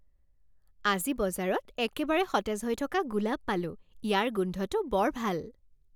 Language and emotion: Assamese, happy